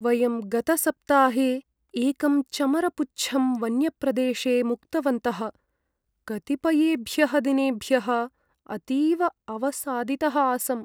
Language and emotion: Sanskrit, sad